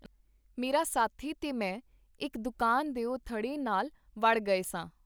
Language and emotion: Punjabi, neutral